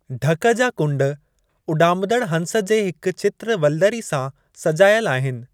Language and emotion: Sindhi, neutral